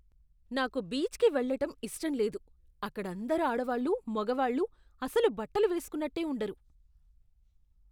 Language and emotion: Telugu, disgusted